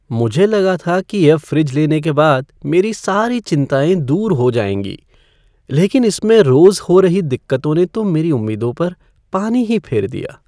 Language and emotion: Hindi, sad